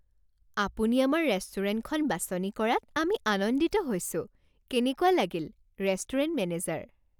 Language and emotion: Assamese, happy